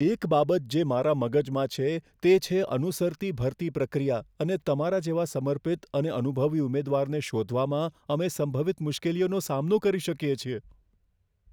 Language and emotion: Gujarati, fearful